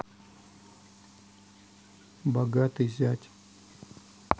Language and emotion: Russian, neutral